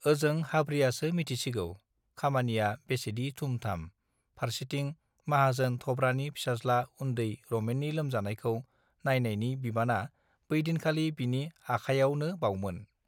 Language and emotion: Bodo, neutral